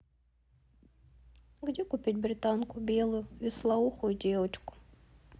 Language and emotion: Russian, sad